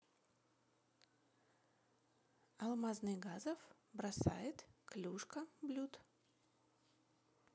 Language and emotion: Russian, neutral